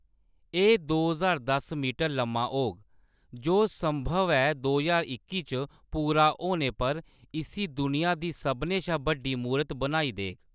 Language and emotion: Dogri, neutral